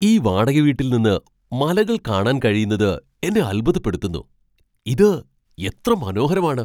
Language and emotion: Malayalam, surprised